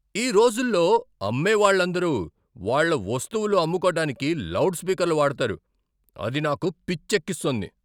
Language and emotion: Telugu, angry